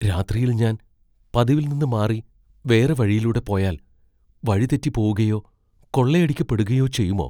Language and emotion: Malayalam, fearful